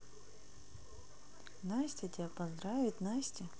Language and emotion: Russian, neutral